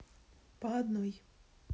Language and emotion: Russian, neutral